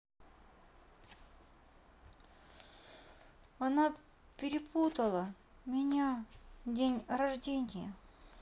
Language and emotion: Russian, sad